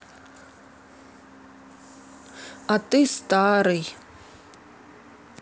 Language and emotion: Russian, sad